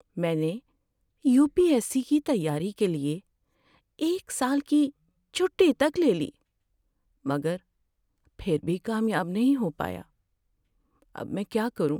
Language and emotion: Urdu, sad